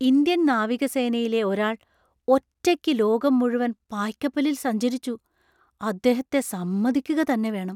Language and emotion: Malayalam, surprised